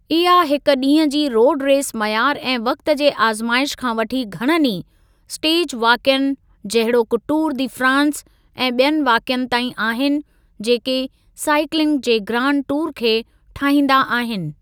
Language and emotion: Sindhi, neutral